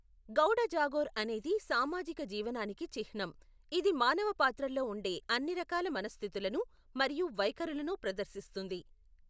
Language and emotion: Telugu, neutral